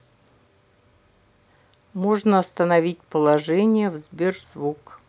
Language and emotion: Russian, neutral